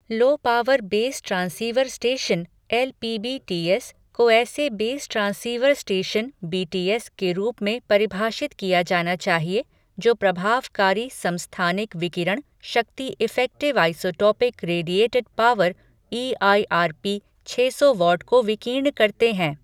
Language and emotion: Hindi, neutral